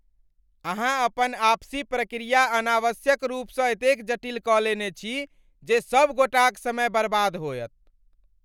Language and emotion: Maithili, angry